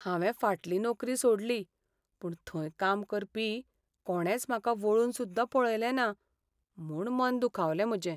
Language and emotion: Goan Konkani, sad